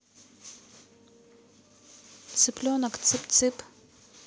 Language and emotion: Russian, neutral